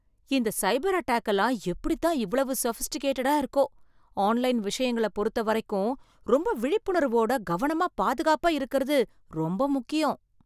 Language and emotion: Tamil, surprised